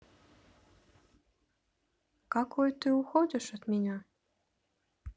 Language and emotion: Russian, sad